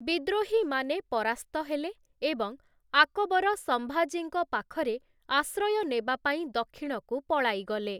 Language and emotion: Odia, neutral